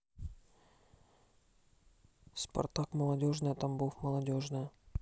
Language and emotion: Russian, neutral